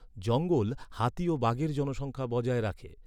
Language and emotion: Bengali, neutral